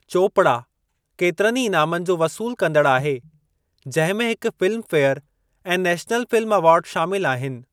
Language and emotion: Sindhi, neutral